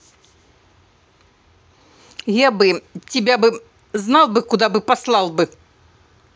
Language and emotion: Russian, angry